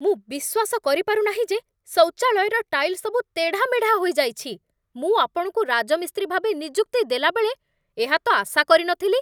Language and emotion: Odia, angry